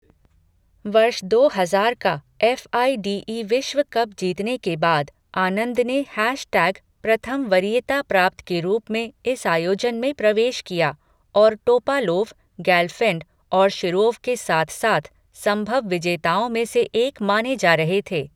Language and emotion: Hindi, neutral